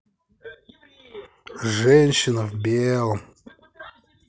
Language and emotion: Russian, neutral